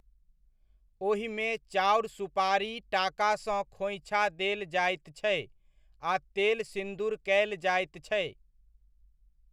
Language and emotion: Maithili, neutral